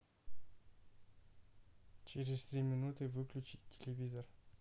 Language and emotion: Russian, neutral